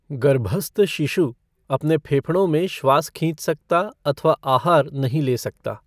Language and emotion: Hindi, neutral